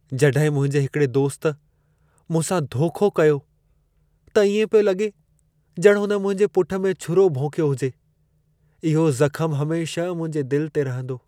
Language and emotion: Sindhi, sad